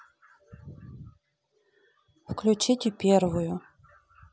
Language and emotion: Russian, neutral